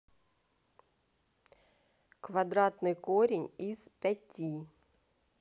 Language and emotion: Russian, neutral